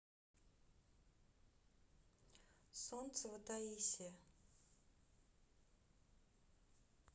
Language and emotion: Russian, neutral